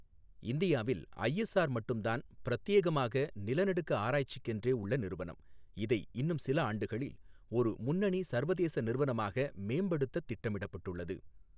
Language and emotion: Tamil, neutral